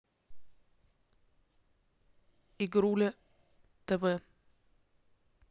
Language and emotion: Russian, neutral